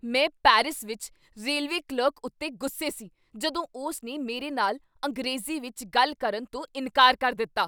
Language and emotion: Punjabi, angry